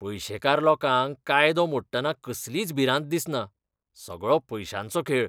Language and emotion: Goan Konkani, disgusted